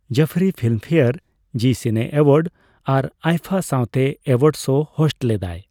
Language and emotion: Santali, neutral